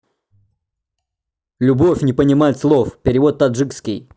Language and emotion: Russian, neutral